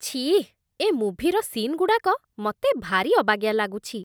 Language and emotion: Odia, disgusted